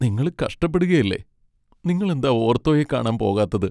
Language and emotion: Malayalam, sad